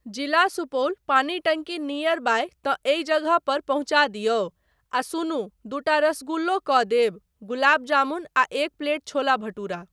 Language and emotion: Maithili, neutral